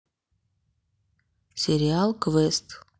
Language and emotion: Russian, neutral